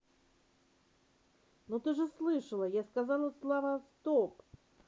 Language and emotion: Russian, neutral